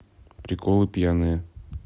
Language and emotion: Russian, neutral